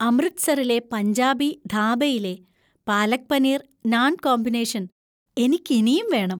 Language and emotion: Malayalam, happy